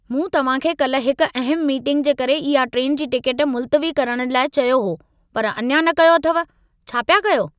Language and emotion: Sindhi, angry